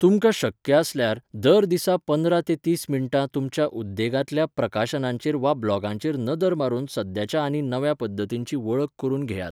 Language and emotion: Goan Konkani, neutral